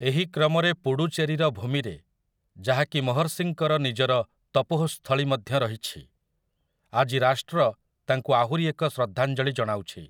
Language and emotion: Odia, neutral